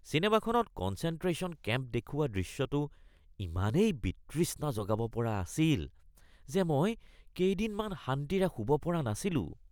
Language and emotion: Assamese, disgusted